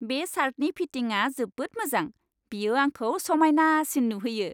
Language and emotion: Bodo, happy